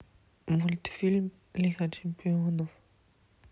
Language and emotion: Russian, neutral